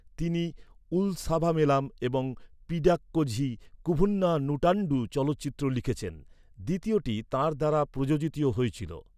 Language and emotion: Bengali, neutral